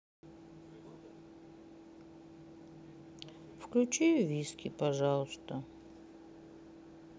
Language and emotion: Russian, sad